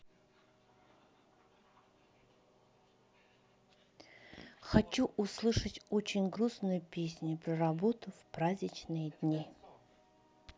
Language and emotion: Russian, sad